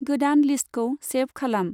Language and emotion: Bodo, neutral